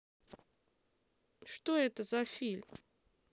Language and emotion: Russian, neutral